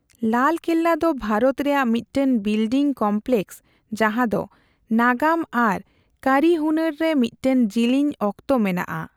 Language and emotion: Santali, neutral